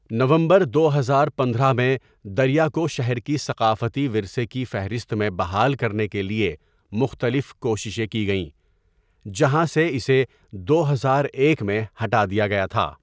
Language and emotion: Urdu, neutral